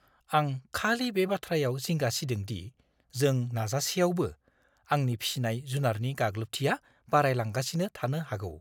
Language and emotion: Bodo, fearful